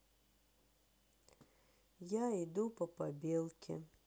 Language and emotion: Russian, sad